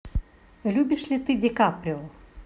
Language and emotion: Russian, neutral